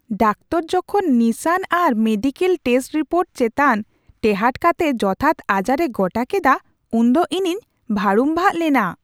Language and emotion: Santali, surprised